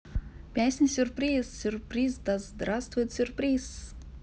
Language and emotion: Russian, positive